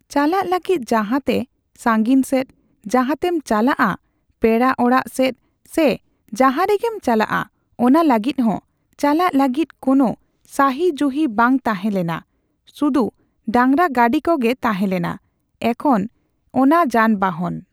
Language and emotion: Santali, neutral